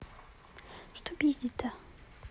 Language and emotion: Russian, neutral